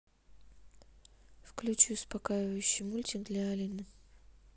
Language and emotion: Russian, neutral